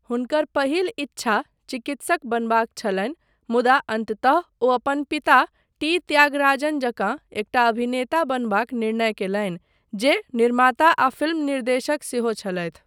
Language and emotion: Maithili, neutral